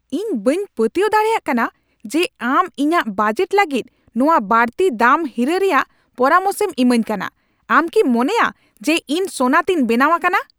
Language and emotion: Santali, angry